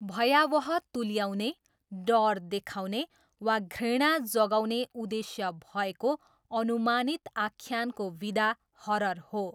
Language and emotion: Nepali, neutral